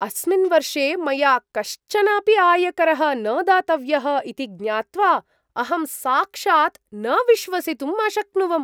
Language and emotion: Sanskrit, surprised